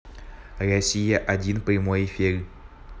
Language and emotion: Russian, neutral